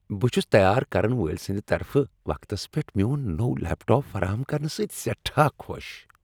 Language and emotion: Kashmiri, happy